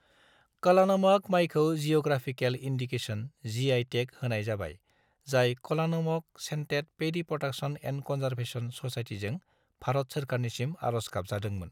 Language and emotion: Bodo, neutral